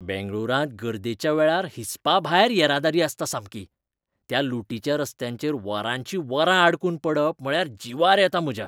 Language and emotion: Goan Konkani, disgusted